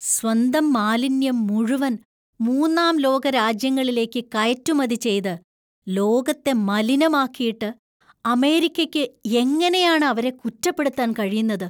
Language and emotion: Malayalam, disgusted